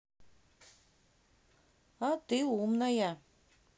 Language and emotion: Russian, neutral